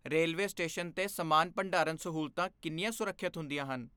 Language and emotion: Punjabi, fearful